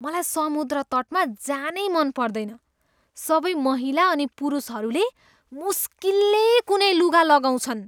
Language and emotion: Nepali, disgusted